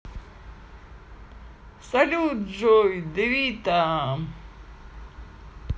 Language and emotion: Russian, positive